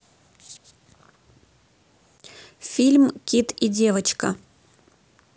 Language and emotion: Russian, neutral